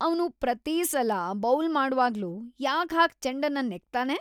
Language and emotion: Kannada, disgusted